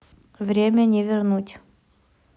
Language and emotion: Russian, neutral